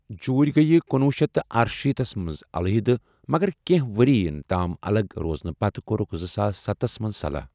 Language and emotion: Kashmiri, neutral